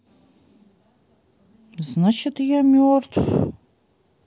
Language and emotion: Russian, sad